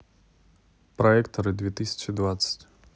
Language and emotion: Russian, neutral